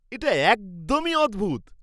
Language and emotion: Bengali, surprised